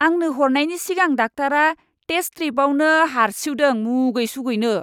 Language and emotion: Bodo, disgusted